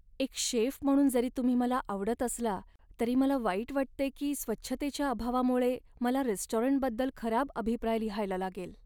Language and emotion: Marathi, sad